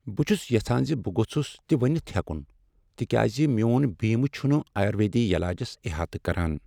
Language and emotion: Kashmiri, sad